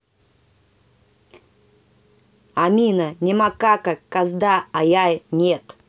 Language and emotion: Russian, angry